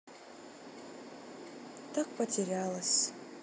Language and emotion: Russian, sad